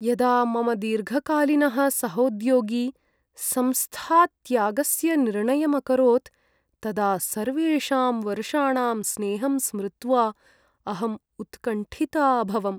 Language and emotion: Sanskrit, sad